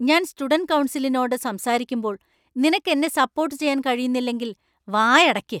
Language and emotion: Malayalam, angry